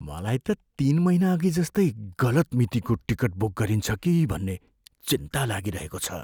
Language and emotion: Nepali, fearful